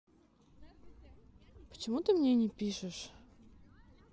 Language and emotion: Russian, neutral